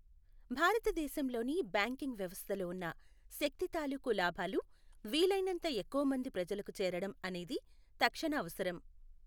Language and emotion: Telugu, neutral